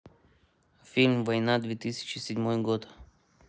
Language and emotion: Russian, neutral